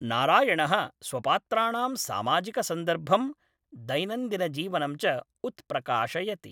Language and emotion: Sanskrit, neutral